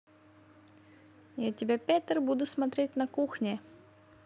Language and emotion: Russian, neutral